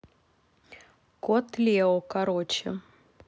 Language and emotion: Russian, neutral